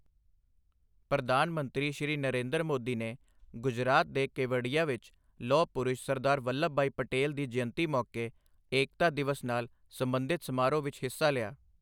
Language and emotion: Punjabi, neutral